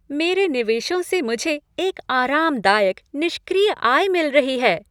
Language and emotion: Hindi, happy